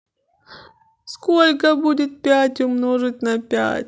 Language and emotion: Russian, sad